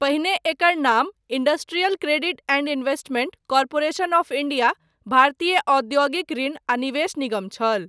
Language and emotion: Maithili, neutral